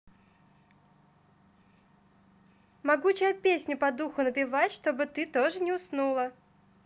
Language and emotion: Russian, positive